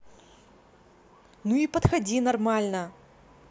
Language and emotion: Russian, angry